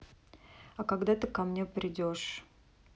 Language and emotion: Russian, neutral